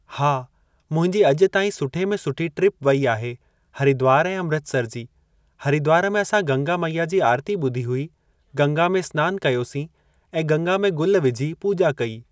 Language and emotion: Sindhi, neutral